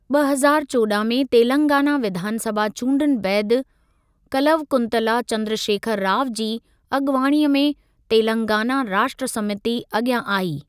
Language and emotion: Sindhi, neutral